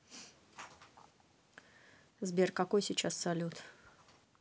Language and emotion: Russian, neutral